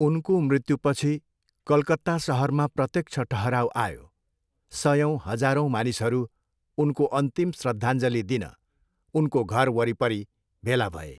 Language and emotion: Nepali, neutral